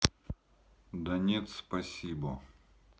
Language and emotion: Russian, neutral